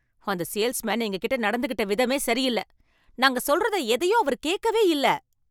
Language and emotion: Tamil, angry